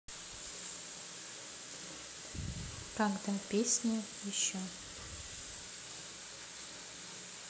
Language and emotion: Russian, neutral